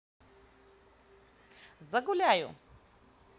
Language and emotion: Russian, positive